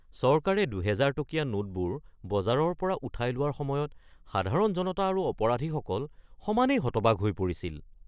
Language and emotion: Assamese, surprised